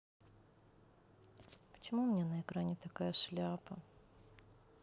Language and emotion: Russian, sad